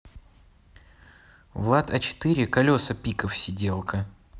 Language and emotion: Russian, neutral